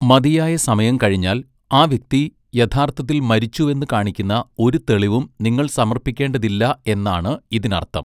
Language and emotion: Malayalam, neutral